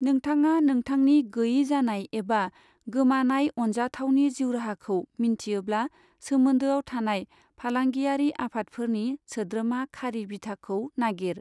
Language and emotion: Bodo, neutral